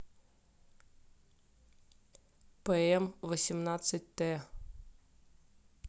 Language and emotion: Russian, neutral